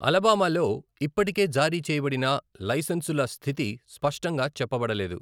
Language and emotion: Telugu, neutral